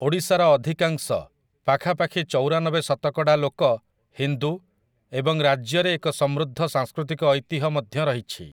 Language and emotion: Odia, neutral